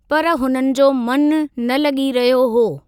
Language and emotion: Sindhi, neutral